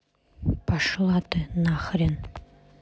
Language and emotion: Russian, neutral